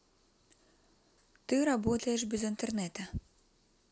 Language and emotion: Russian, neutral